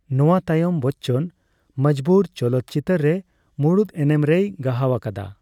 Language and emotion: Santali, neutral